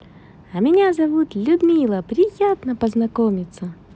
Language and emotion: Russian, positive